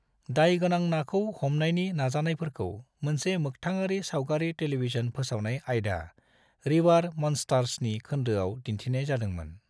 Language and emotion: Bodo, neutral